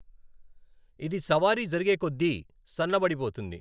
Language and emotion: Telugu, neutral